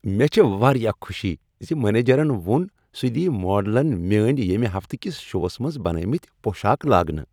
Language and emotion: Kashmiri, happy